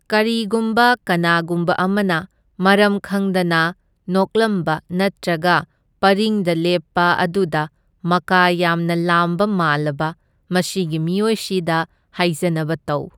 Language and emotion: Manipuri, neutral